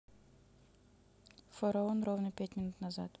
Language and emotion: Russian, neutral